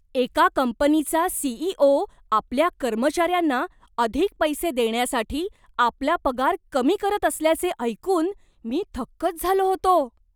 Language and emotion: Marathi, surprised